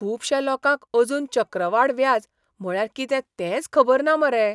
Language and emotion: Goan Konkani, surprised